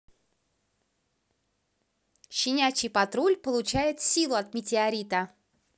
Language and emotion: Russian, positive